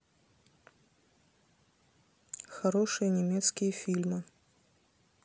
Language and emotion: Russian, neutral